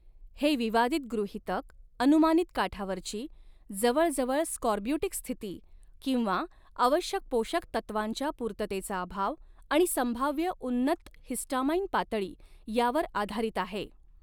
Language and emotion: Marathi, neutral